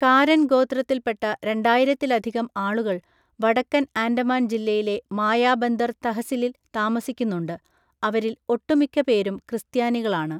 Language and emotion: Malayalam, neutral